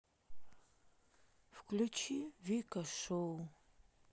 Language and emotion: Russian, sad